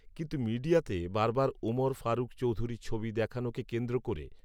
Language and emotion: Bengali, neutral